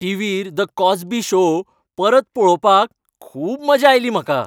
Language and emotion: Goan Konkani, happy